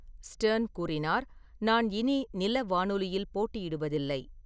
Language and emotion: Tamil, neutral